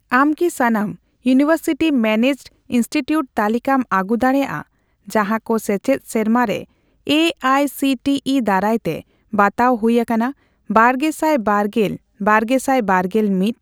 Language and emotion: Santali, neutral